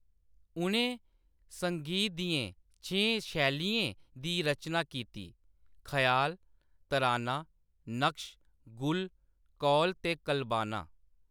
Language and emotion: Dogri, neutral